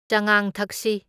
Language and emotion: Manipuri, neutral